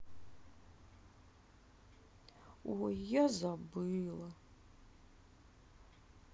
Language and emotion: Russian, sad